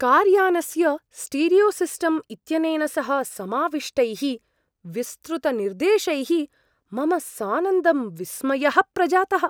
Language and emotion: Sanskrit, surprised